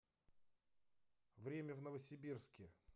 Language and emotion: Russian, neutral